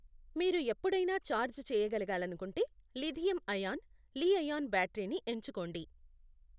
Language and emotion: Telugu, neutral